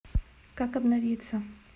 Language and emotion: Russian, neutral